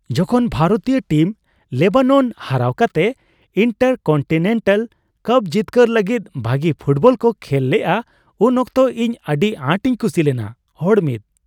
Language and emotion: Santali, happy